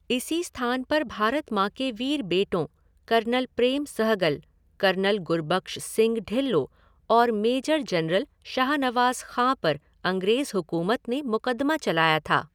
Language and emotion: Hindi, neutral